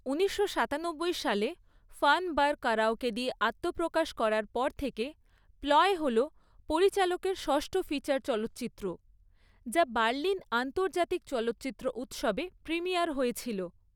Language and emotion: Bengali, neutral